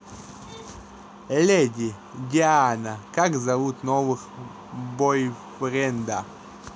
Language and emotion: Russian, neutral